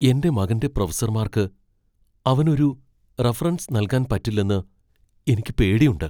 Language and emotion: Malayalam, fearful